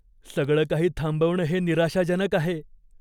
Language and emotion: Marathi, fearful